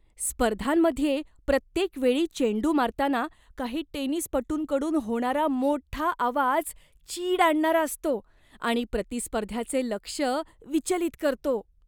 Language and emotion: Marathi, disgusted